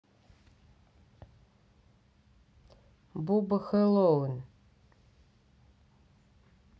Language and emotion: Russian, neutral